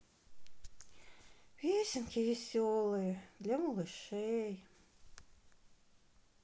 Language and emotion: Russian, sad